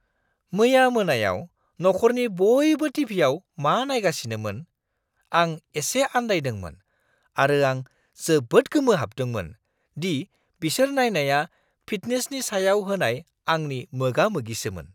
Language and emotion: Bodo, surprised